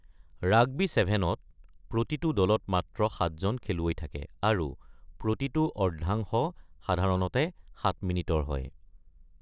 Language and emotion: Assamese, neutral